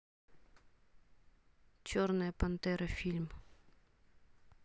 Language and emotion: Russian, neutral